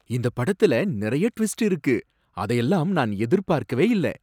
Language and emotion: Tamil, surprised